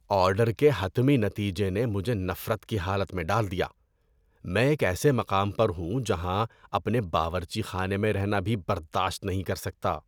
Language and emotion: Urdu, disgusted